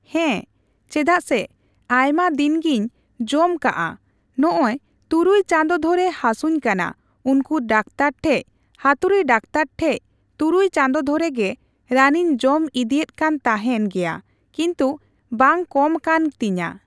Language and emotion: Santali, neutral